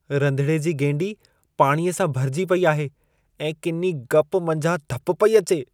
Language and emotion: Sindhi, disgusted